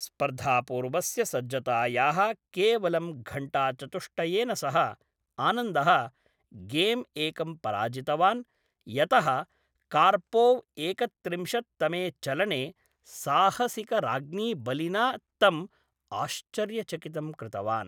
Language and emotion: Sanskrit, neutral